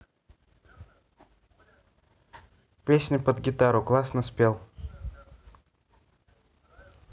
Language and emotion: Russian, neutral